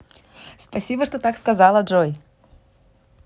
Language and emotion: Russian, positive